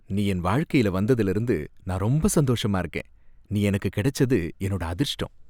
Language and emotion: Tamil, happy